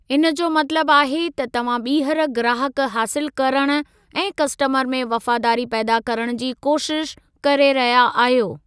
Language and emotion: Sindhi, neutral